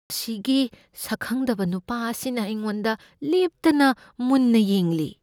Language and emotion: Manipuri, fearful